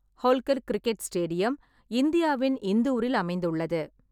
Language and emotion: Tamil, neutral